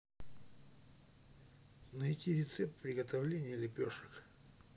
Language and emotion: Russian, neutral